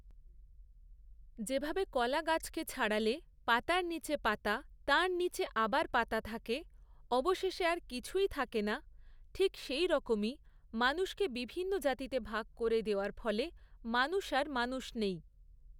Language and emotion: Bengali, neutral